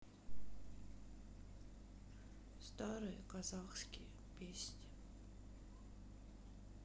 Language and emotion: Russian, sad